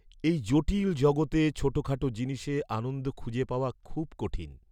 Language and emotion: Bengali, sad